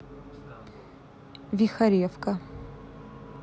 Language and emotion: Russian, neutral